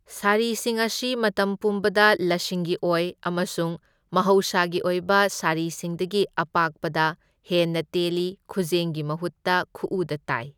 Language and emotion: Manipuri, neutral